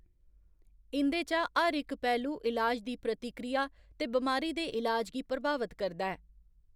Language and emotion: Dogri, neutral